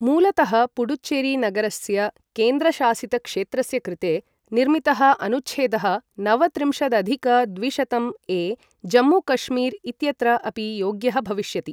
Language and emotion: Sanskrit, neutral